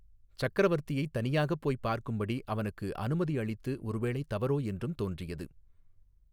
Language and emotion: Tamil, neutral